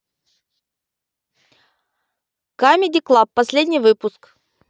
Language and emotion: Russian, neutral